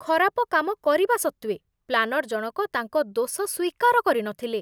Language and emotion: Odia, disgusted